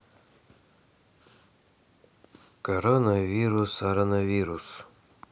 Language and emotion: Russian, neutral